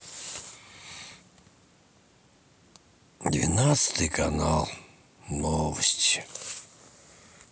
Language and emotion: Russian, sad